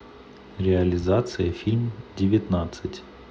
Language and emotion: Russian, neutral